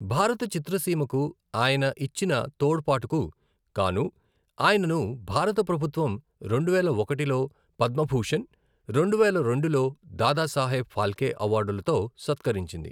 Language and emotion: Telugu, neutral